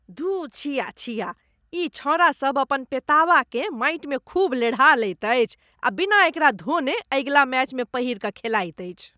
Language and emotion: Maithili, disgusted